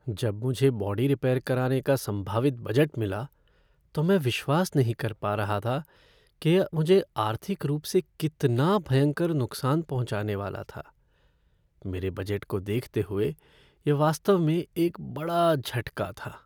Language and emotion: Hindi, sad